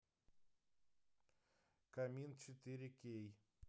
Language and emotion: Russian, neutral